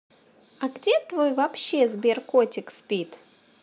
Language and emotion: Russian, positive